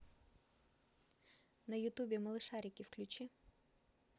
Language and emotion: Russian, neutral